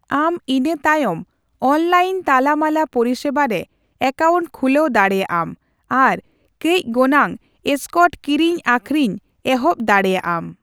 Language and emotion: Santali, neutral